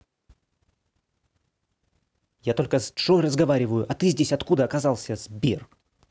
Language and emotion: Russian, angry